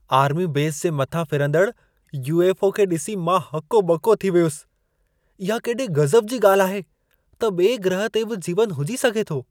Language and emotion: Sindhi, surprised